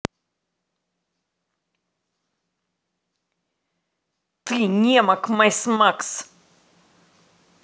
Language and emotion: Russian, angry